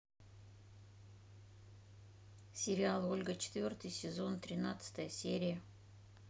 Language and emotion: Russian, neutral